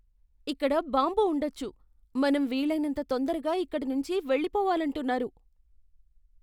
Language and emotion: Telugu, fearful